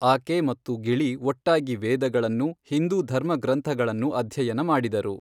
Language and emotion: Kannada, neutral